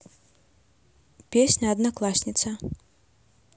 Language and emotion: Russian, neutral